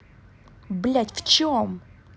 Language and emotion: Russian, angry